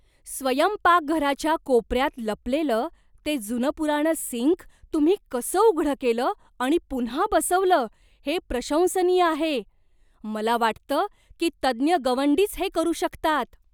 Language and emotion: Marathi, surprised